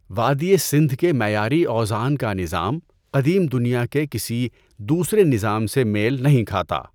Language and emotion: Urdu, neutral